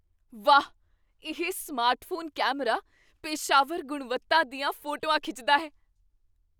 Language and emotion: Punjabi, surprised